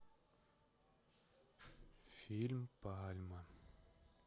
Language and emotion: Russian, sad